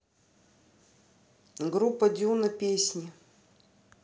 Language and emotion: Russian, neutral